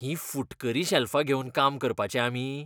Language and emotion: Goan Konkani, disgusted